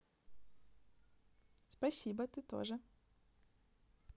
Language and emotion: Russian, positive